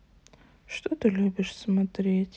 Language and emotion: Russian, sad